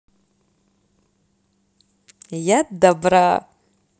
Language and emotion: Russian, positive